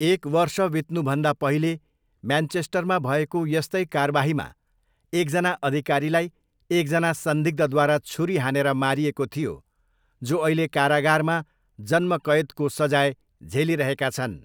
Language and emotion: Nepali, neutral